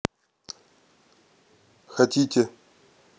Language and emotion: Russian, neutral